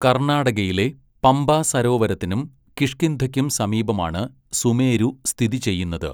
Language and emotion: Malayalam, neutral